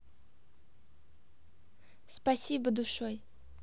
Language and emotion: Russian, positive